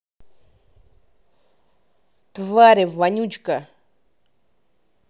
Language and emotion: Russian, angry